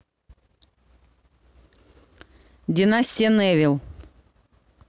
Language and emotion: Russian, neutral